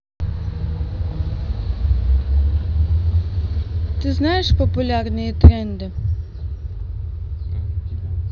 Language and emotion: Russian, neutral